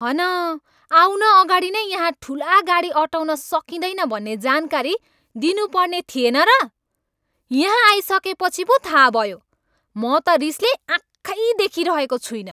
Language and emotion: Nepali, angry